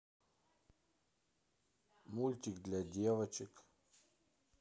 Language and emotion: Russian, neutral